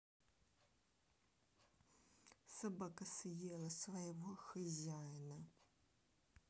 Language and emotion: Russian, neutral